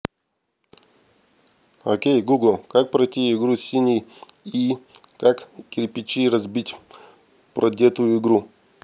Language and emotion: Russian, neutral